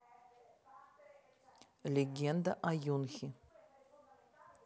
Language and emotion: Russian, neutral